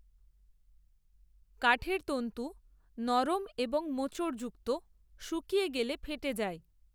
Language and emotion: Bengali, neutral